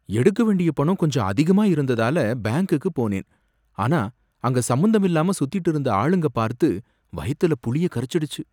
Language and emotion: Tamil, fearful